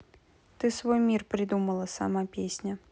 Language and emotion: Russian, neutral